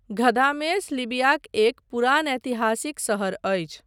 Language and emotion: Maithili, neutral